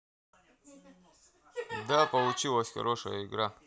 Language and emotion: Russian, neutral